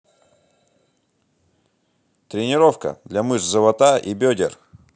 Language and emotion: Russian, positive